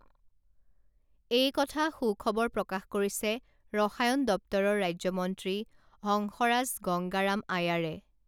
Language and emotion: Assamese, neutral